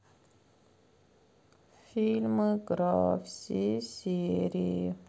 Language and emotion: Russian, sad